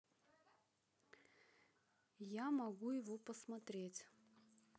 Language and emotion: Russian, neutral